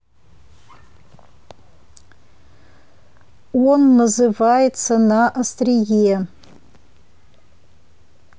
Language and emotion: Russian, neutral